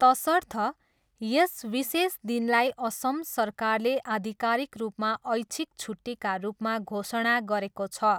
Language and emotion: Nepali, neutral